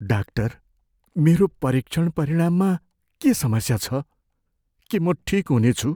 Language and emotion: Nepali, fearful